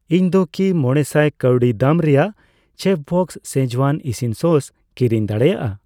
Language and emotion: Santali, neutral